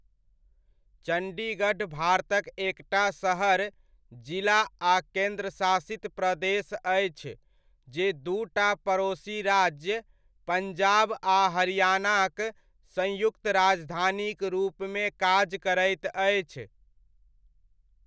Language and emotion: Maithili, neutral